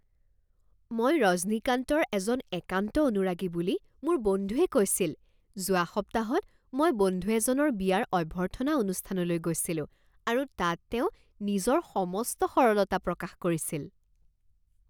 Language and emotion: Assamese, surprised